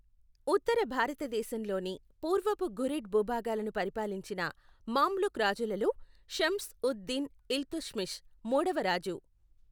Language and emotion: Telugu, neutral